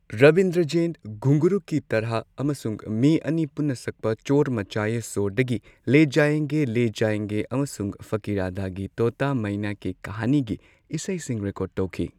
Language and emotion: Manipuri, neutral